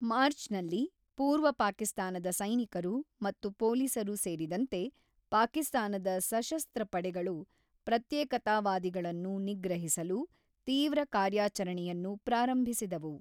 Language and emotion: Kannada, neutral